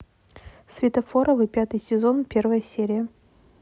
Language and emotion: Russian, neutral